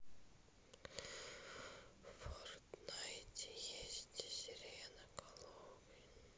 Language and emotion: Russian, neutral